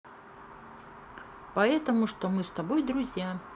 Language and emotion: Russian, neutral